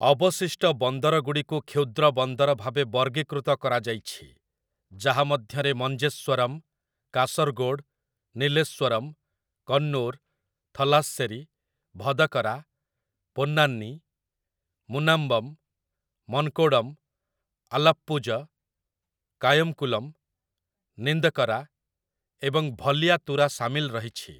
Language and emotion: Odia, neutral